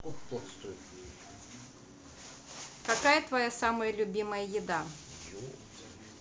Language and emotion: Russian, neutral